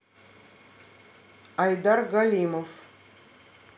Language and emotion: Russian, neutral